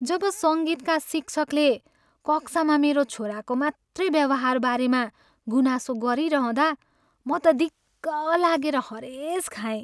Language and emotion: Nepali, sad